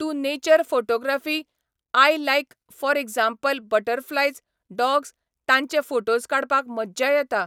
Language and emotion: Goan Konkani, neutral